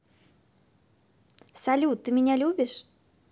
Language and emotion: Russian, positive